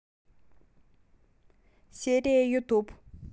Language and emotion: Russian, neutral